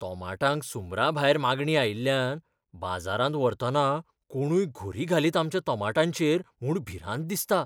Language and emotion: Goan Konkani, fearful